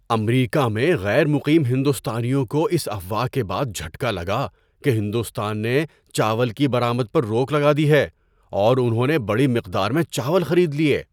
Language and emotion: Urdu, surprised